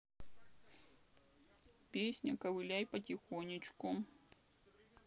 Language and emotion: Russian, sad